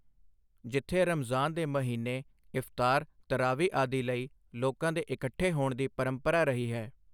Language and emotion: Punjabi, neutral